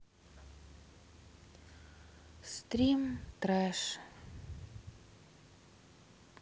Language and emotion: Russian, sad